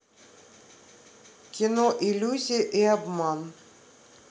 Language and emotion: Russian, neutral